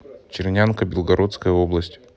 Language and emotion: Russian, neutral